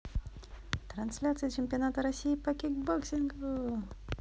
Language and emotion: Russian, positive